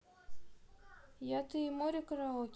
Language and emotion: Russian, neutral